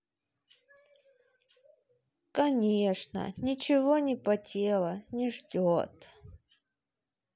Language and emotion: Russian, sad